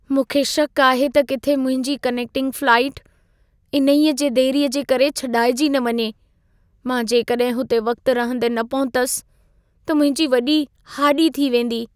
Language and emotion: Sindhi, fearful